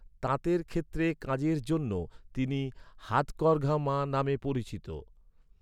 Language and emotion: Bengali, neutral